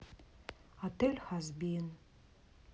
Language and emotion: Russian, sad